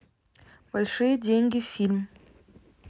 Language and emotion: Russian, neutral